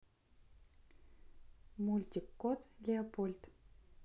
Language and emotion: Russian, neutral